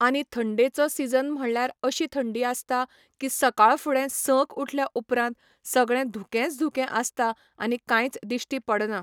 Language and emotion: Goan Konkani, neutral